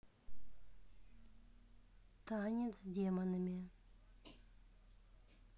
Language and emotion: Russian, neutral